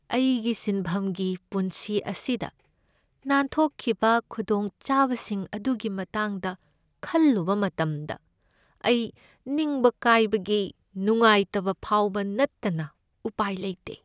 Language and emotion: Manipuri, sad